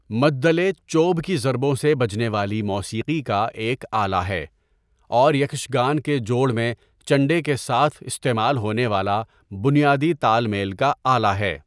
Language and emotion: Urdu, neutral